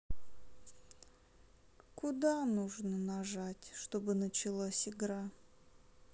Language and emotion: Russian, sad